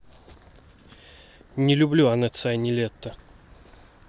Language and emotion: Russian, neutral